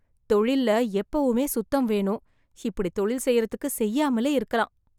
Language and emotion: Tamil, disgusted